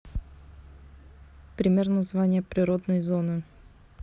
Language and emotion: Russian, neutral